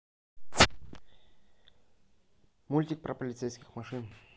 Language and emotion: Russian, neutral